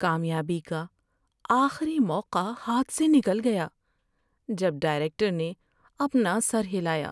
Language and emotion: Urdu, sad